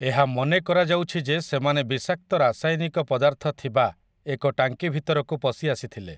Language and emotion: Odia, neutral